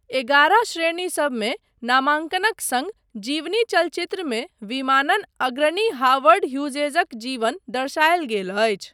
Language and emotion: Maithili, neutral